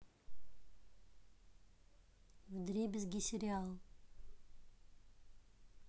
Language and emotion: Russian, neutral